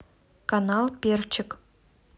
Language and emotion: Russian, neutral